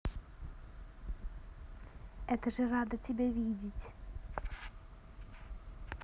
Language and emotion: Russian, positive